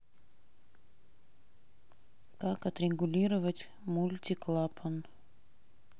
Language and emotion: Russian, neutral